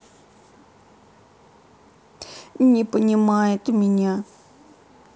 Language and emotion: Russian, sad